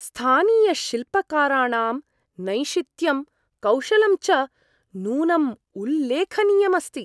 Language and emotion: Sanskrit, surprised